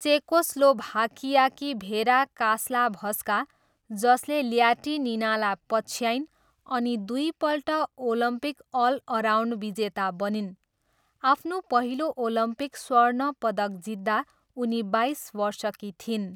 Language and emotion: Nepali, neutral